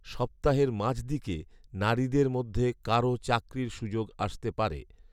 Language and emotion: Bengali, neutral